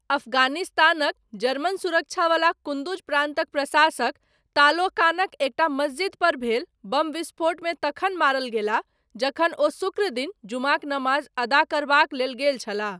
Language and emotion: Maithili, neutral